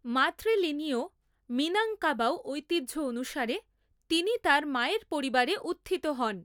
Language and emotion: Bengali, neutral